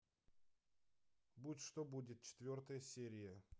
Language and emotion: Russian, neutral